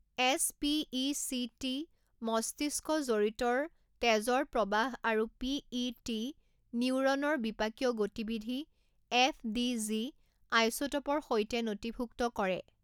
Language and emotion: Assamese, neutral